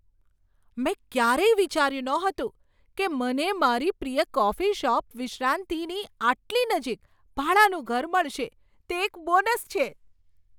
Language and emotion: Gujarati, surprised